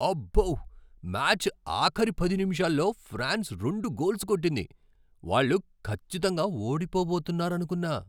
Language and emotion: Telugu, surprised